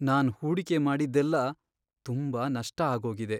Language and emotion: Kannada, sad